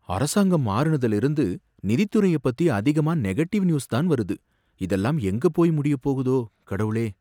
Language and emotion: Tamil, fearful